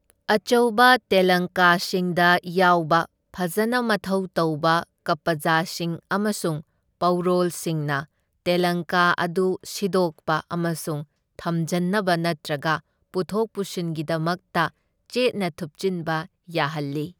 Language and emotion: Manipuri, neutral